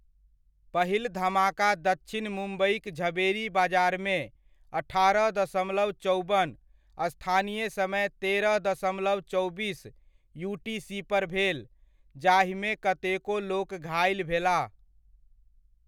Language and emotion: Maithili, neutral